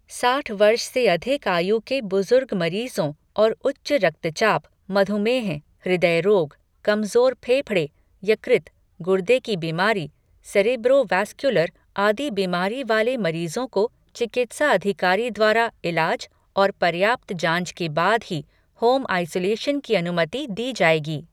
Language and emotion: Hindi, neutral